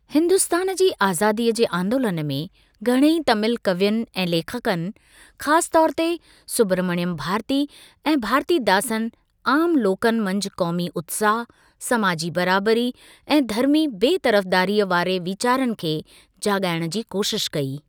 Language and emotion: Sindhi, neutral